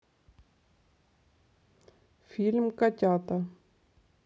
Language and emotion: Russian, neutral